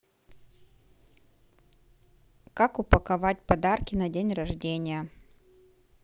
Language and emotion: Russian, neutral